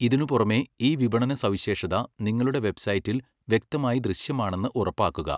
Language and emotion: Malayalam, neutral